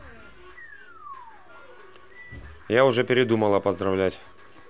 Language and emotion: Russian, neutral